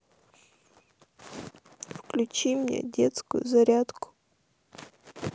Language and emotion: Russian, sad